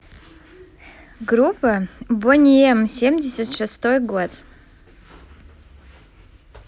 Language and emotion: Russian, positive